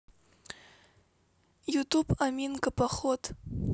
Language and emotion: Russian, neutral